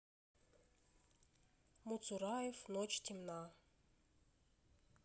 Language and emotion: Russian, neutral